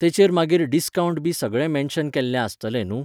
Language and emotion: Goan Konkani, neutral